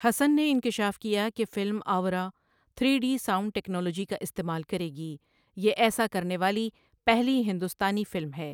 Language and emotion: Urdu, neutral